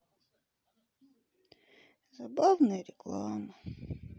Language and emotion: Russian, sad